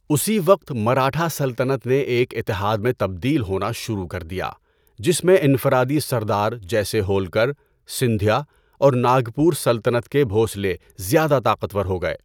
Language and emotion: Urdu, neutral